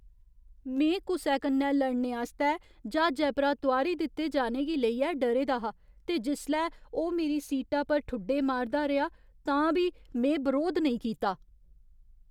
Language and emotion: Dogri, fearful